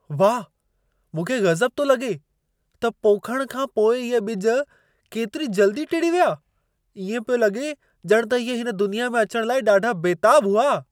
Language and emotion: Sindhi, surprised